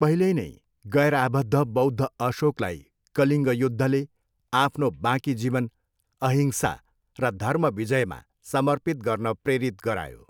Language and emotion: Nepali, neutral